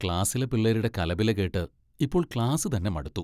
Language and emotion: Malayalam, disgusted